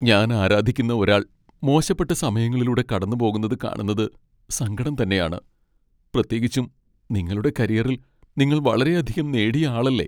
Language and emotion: Malayalam, sad